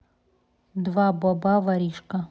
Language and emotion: Russian, neutral